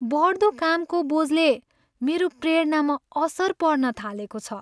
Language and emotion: Nepali, sad